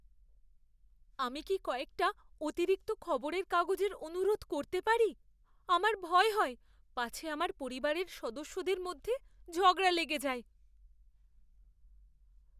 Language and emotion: Bengali, fearful